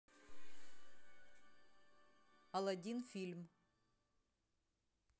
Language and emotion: Russian, neutral